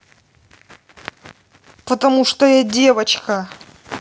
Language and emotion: Russian, angry